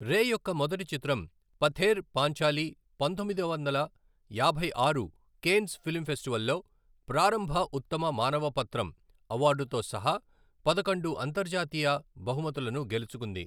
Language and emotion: Telugu, neutral